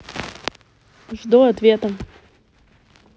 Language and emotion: Russian, neutral